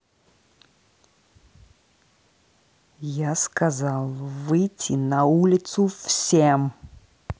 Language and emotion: Russian, angry